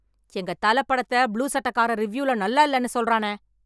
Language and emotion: Tamil, angry